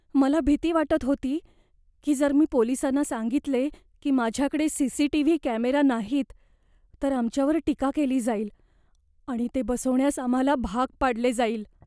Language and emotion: Marathi, fearful